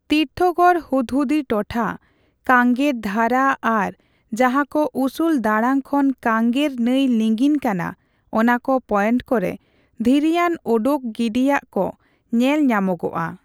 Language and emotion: Santali, neutral